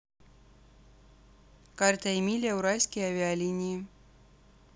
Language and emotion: Russian, neutral